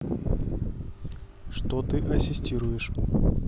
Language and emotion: Russian, neutral